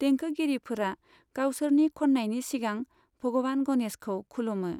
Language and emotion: Bodo, neutral